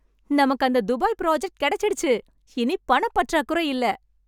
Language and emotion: Tamil, happy